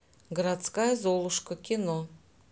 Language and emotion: Russian, neutral